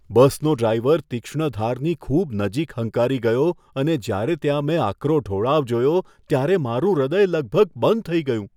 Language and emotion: Gujarati, fearful